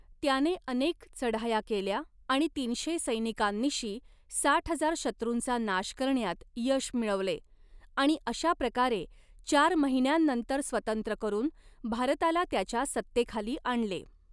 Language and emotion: Marathi, neutral